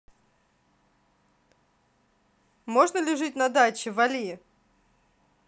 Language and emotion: Russian, neutral